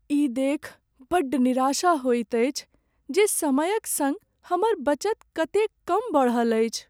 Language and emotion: Maithili, sad